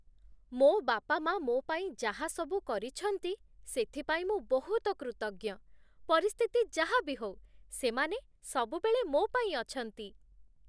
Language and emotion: Odia, happy